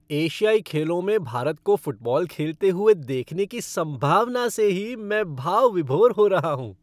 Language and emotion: Hindi, happy